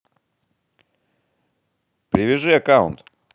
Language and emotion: Russian, positive